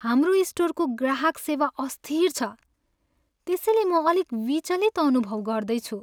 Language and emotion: Nepali, sad